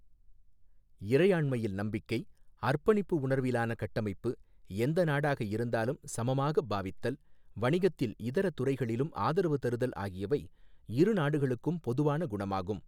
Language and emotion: Tamil, neutral